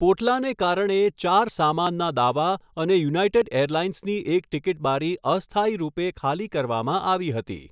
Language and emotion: Gujarati, neutral